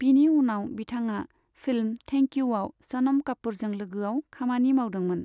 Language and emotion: Bodo, neutral